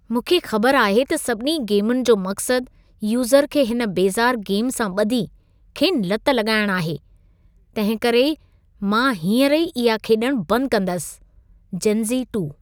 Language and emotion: Sindhi, disgusted